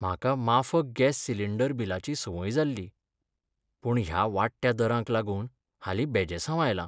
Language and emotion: Goan Konkani, sad